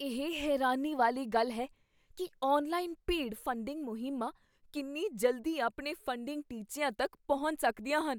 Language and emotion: Punjabi, surprised